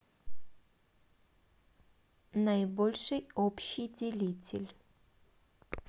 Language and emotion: Russian, neutral